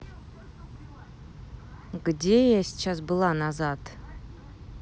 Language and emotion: Russian, neutral